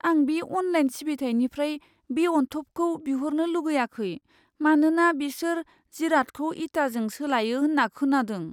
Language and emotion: Bodo, fearful